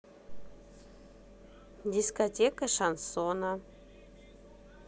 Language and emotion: Russian, neutral